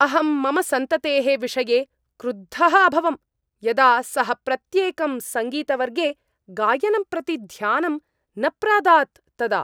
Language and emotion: Sanskrit, angry